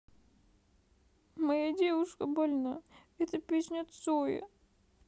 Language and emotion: Russian, sad